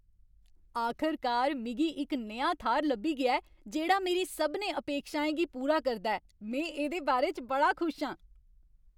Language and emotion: Dogri, happy